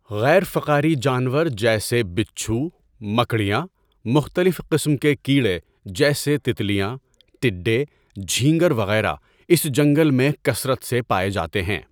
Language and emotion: Urdu, neutral